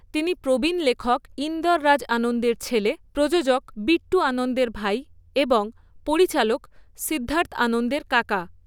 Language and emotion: Bengali, neutral